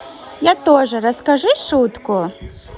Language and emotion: Russian, positive